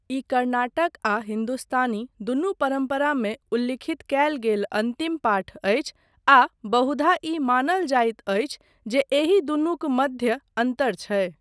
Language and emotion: Maithili, neutral